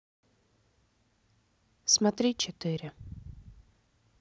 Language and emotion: Russian, neutral